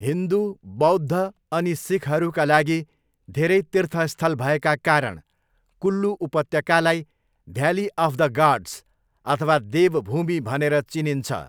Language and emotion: Nepali, neutral